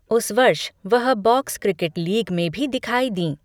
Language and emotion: Hindi, neutral